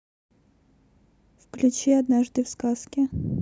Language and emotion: Russian, neutral